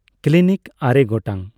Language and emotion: Santali, neutral